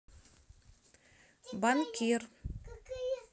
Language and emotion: Russian, neutral